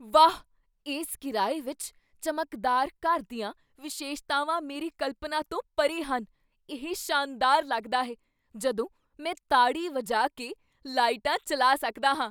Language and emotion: Punjabi, surprised